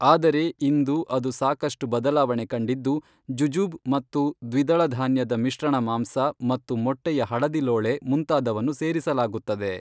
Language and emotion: Kannada, neutral